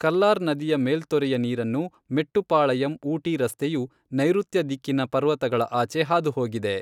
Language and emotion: Kannada, neutral